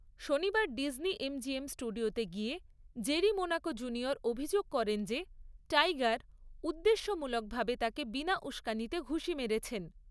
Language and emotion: Bengali, neutral